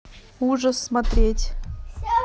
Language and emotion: Russian, neutral